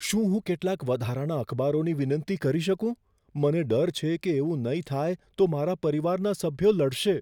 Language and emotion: Gujarati, fearful